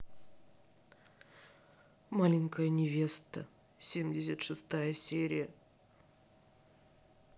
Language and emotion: Russian, sad